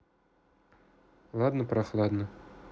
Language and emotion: Russian, neutral